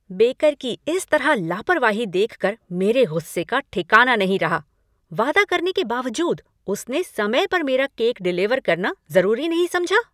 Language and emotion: Hindi, angry